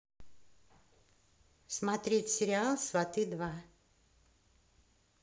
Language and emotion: Russian, neutral